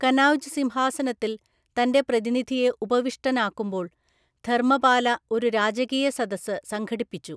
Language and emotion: Malayalam, neutral